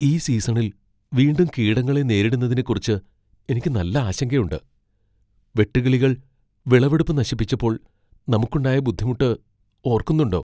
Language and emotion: Malayalam, fearful